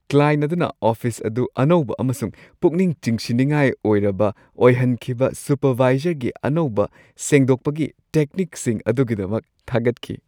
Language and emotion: Manipuri, happy